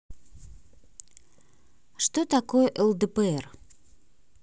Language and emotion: Russian, neutral